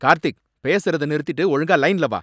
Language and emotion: Tamil, angry